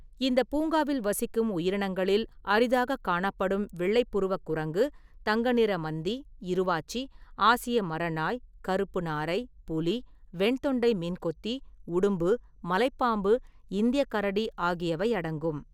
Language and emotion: Tamil, neutral